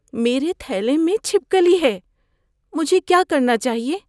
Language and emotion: Urdu, fearful